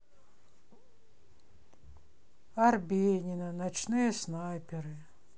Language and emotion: Russian, sad